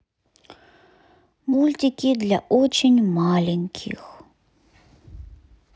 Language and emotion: Russian, neutral